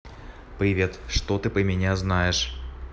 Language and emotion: Russian, neutral